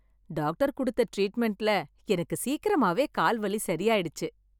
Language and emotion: Tamil, happy